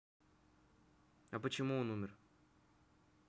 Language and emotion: Russian, neutral